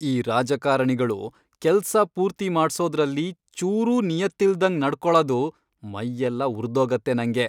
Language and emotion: Kannada, angry